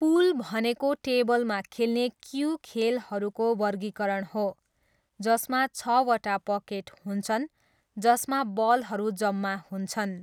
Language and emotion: Nepali, neutral